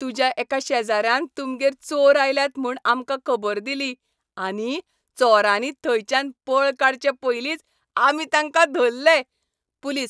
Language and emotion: Goan Konkani, happy